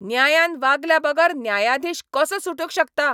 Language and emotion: Goan Konkani, angry